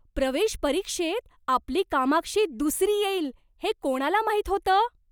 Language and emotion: Marathi, surprised